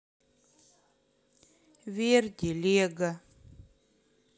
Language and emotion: Russian, sad